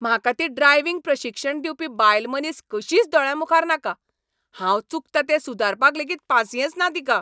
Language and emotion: Goan Konkani, angry